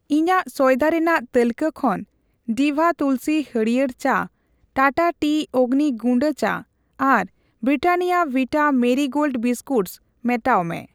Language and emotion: Santali, neutral